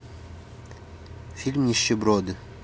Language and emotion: Russian, neutral